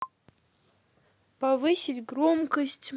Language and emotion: Russian, neutral